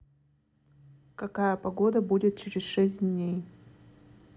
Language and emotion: Russian, neutral